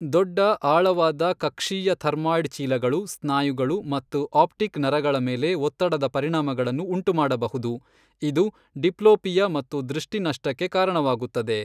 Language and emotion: Kannada, neutral